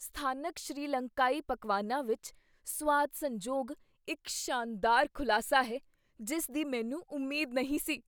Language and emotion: Punjabi, surprised